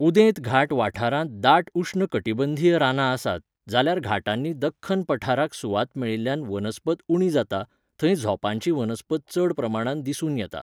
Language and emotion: Goan Konkani, neutral